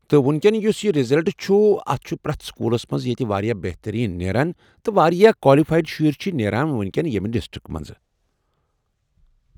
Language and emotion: Kashmiri, neutral